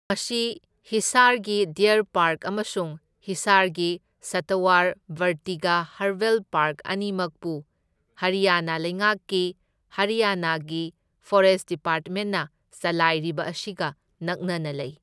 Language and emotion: Manipuri, neutral